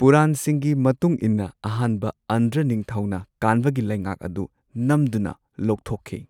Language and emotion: Manipuri, neutral